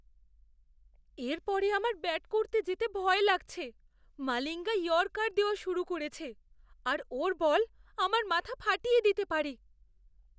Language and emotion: Bengali, fearful